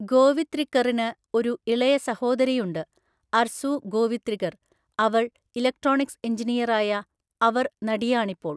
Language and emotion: Malayalam, neutral